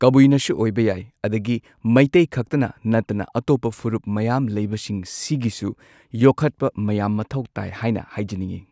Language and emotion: Manipuri, neutral